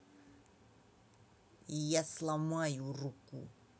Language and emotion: Russian, angry